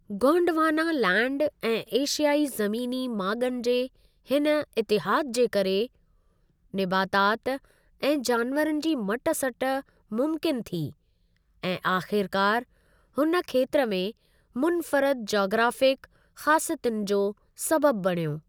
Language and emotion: Sindhi, neutral